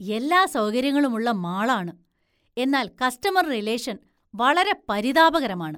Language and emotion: Malayalam, disgusted